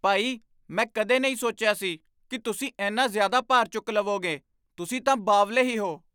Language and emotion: Punjabi, surprised